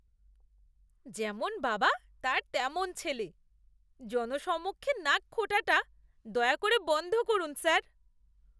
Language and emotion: Bengali, disgusted